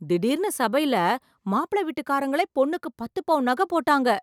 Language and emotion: Tamil, surprised